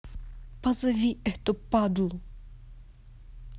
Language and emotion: Russian, angry